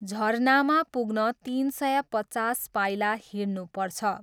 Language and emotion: Nepali, neutral